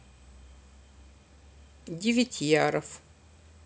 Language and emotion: Russian, neutral